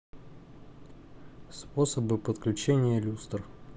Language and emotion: Russian, neutral